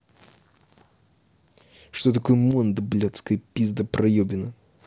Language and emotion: Russian, angry